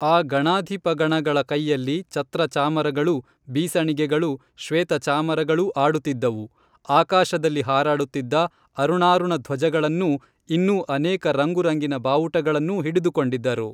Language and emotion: Kannada, neutral